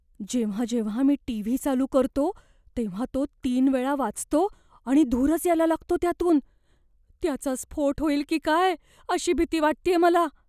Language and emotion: Marathi, fearful